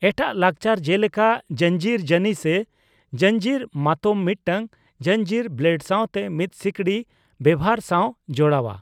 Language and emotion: Santali, neutral